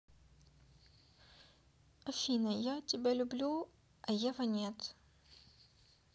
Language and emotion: Russian, neutral